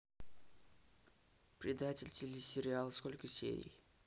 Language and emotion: Russian, neutral